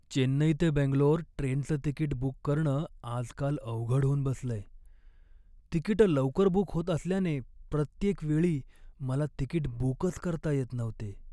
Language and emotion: Marathi, sad